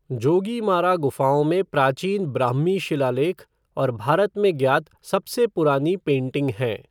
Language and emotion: Hindi, neutral